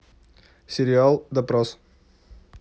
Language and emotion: Russian, neutral